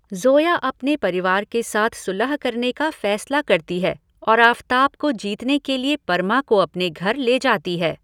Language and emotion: Hindi, neutral